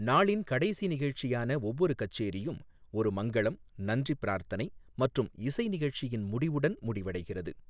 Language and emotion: Tamil, neutral